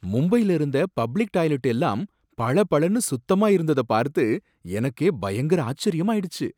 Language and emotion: Tamil, surprised